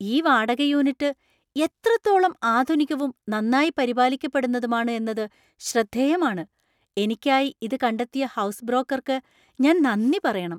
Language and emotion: Malayalam, surprised